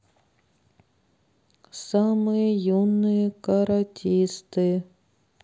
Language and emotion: Russian, neutral